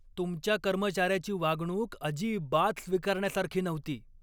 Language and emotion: Marathi, angry